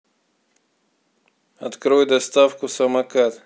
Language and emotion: Russian, neutral